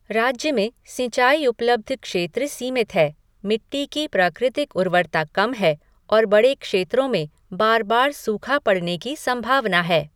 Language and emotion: Hindi, neutral